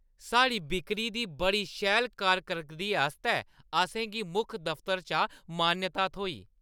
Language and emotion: Dogri, happy